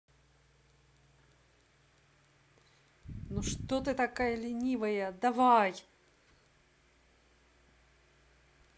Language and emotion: Russian, angry